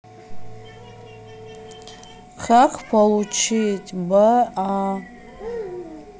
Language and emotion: Russian, neutral